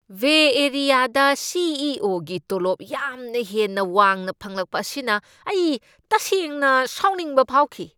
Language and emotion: Manipuri, angry